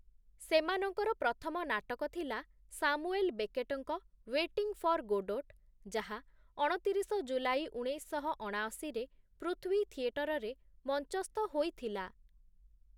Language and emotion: Odia, neutral